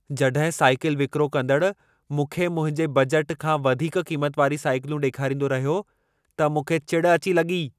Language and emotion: Sindhi, angry